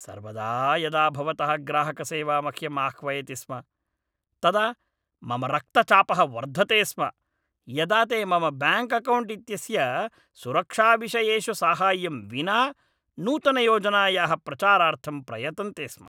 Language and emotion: Sanskrit, angry